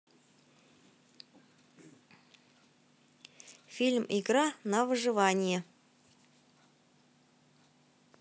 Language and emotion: Russian, positive